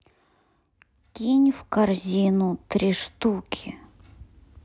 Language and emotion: Russian, sad